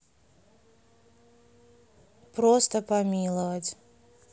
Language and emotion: Russian, neutral